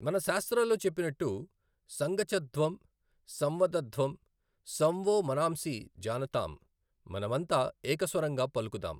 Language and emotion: Telugu, neutral